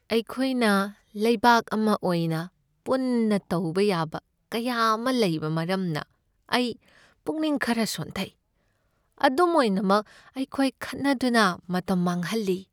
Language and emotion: Manipuri, sad